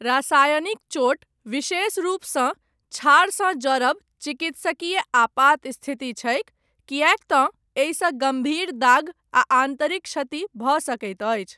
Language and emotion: Maithili, neutral